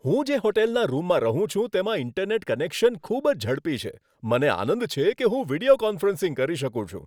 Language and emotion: Gujarati, happy